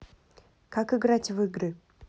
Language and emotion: Russian, neutral